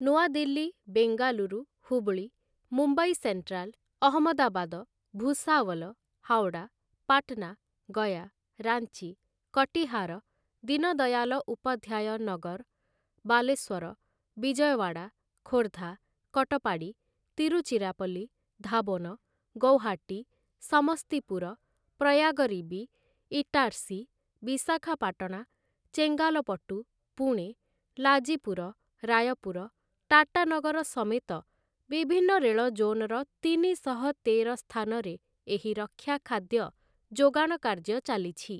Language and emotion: Odia, neutral